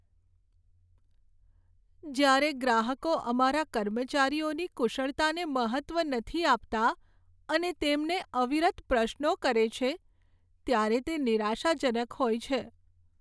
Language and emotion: Gujarati, sad